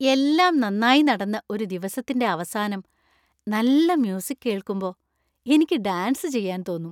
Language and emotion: Malayalam, happy